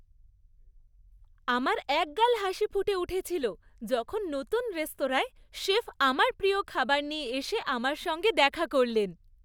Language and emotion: Bengali, happy